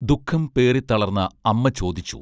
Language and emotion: Malayalam, neutral